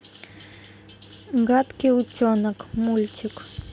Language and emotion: Russian, neutral